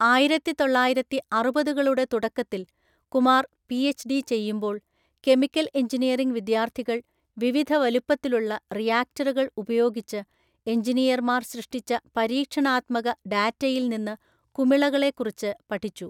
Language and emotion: Malayalam, neutral